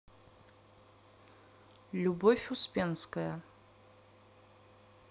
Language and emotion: Russian, neutral